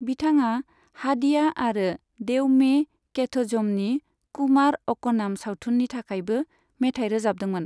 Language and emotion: Bodo, neutral